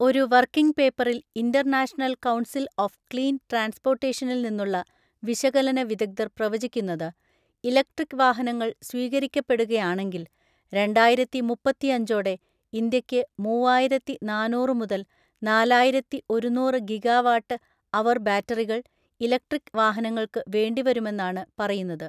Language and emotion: Malayalam, neutral